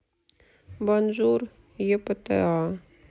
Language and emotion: Russian, sad